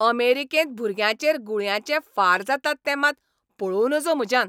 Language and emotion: Goan Konkani, angry